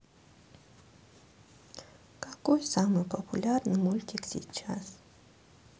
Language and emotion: Russian, sad